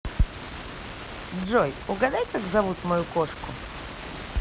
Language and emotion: Russian, positive